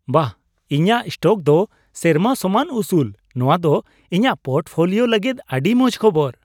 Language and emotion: Santali, happy